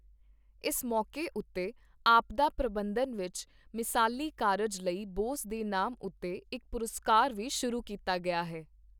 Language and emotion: Punjabi, neutral